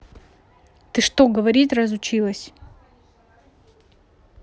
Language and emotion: Russian, angry